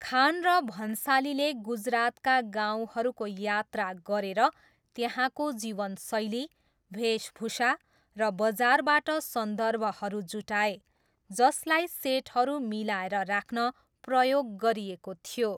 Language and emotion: Nepali, neutral